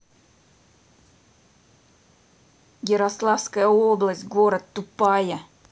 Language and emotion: Russian, angry